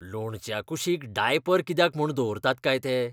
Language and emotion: Goan Konkani, disgusted